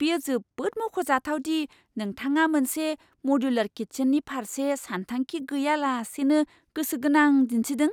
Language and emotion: Bodo, surprised